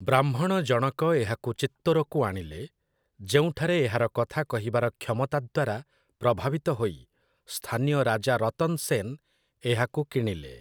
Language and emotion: Odia, neutral